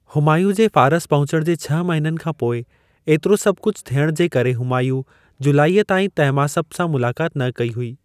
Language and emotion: Sindhi, neutral